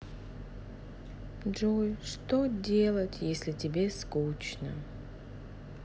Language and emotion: Russian, sad